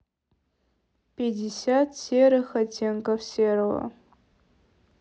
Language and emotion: Russian, neutral